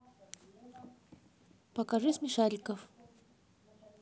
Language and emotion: Russian, neutral